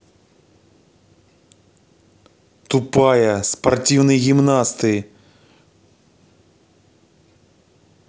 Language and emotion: Russian, angry